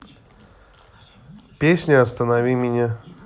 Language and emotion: Russian, neutral